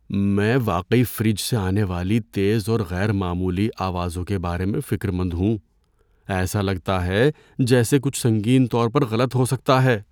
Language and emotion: Urdu, fearful